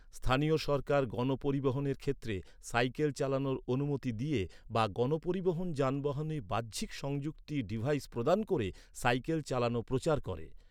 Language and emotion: Bengali, neutral